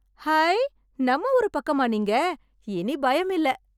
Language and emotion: Tamil, happy